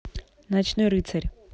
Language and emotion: Russian, neutral